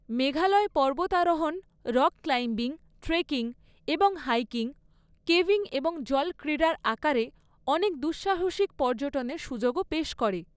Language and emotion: Bengali, neutral